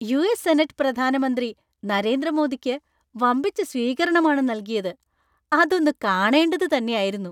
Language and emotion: Malayalam, happy